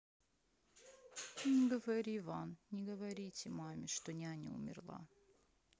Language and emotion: Russian, sad